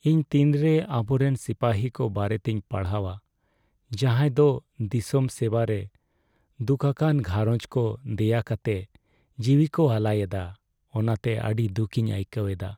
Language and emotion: Santali, sad